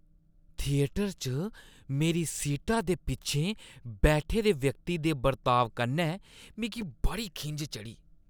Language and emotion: Dogri, disgusted